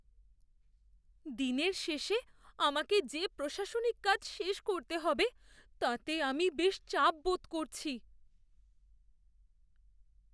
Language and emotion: Bengali, fearful